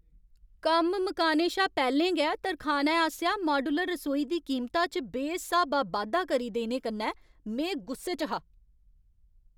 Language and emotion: Dogri, angry